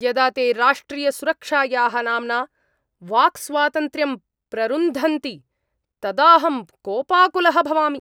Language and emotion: Sanskrit, angry